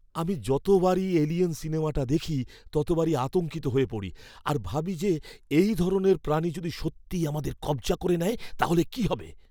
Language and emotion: Bengali, fearful